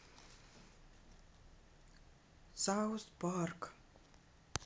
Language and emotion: Russian, neutral